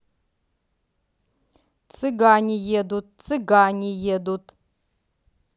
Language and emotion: Russian, neutral